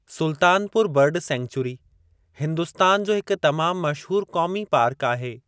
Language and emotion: Sindhi, neutral